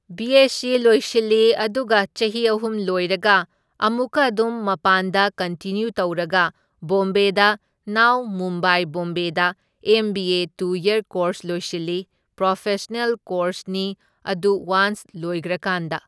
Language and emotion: Manipuri, neutral